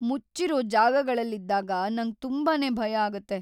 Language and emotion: Kannada, fearful